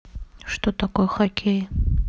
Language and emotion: Russian, neutral